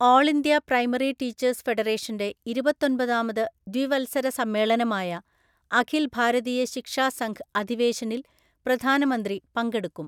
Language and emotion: Malayalam, neutral